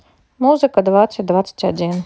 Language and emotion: Russian, neutral